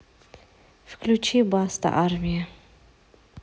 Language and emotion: Russian, neutral